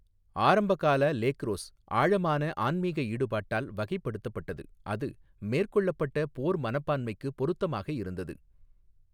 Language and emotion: Tamil, neutral